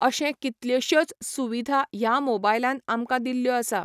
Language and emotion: Goan Konkani, neutral